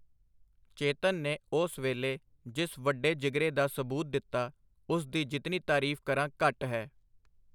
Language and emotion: Punjabi, neutral